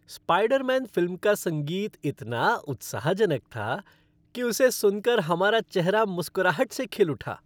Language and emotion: Hindi, happy